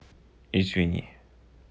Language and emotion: Russian, neutral